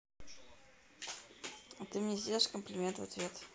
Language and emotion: Russian, neutral